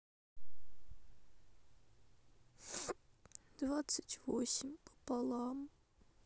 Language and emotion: Russian, sad